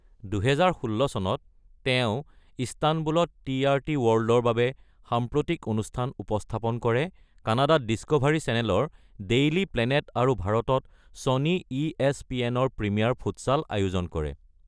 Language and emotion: Assamese, neutral